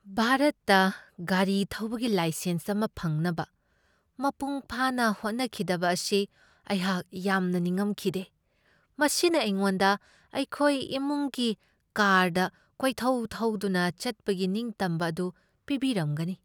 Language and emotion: Manipuri, sad